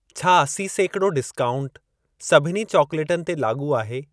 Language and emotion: Sindhi, neutral